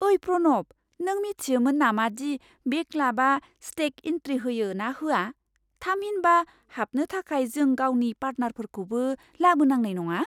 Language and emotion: Bodo, surprised